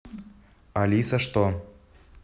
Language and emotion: Russian, neutral